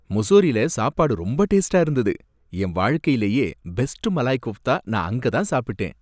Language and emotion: Tamil, happy